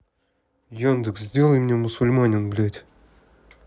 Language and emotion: Russian, neutral